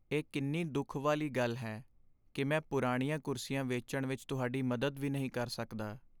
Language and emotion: Punjabi, sad